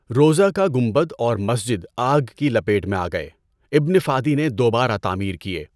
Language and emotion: Urdu, neutral